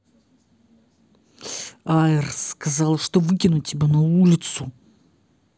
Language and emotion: Russian, angry